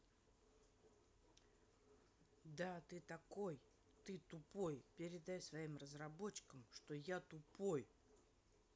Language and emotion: Russian, angry